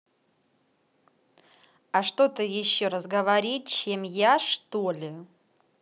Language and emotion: Russian, neutral